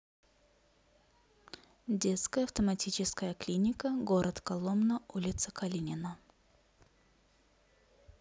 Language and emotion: Russian, neutral